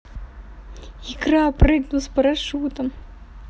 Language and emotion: Russian, positive